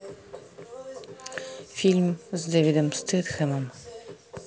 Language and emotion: Russian, neutral